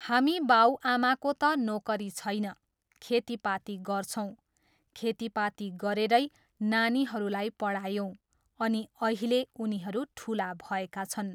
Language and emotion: Nepali, neutral